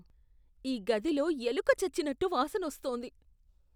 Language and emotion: Telugu, disgusted